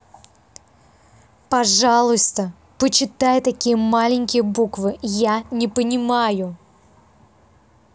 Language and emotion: Russian, angry